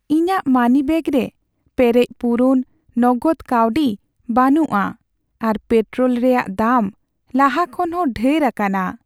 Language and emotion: Santali, sad